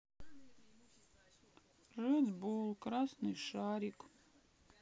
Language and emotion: Russian, sad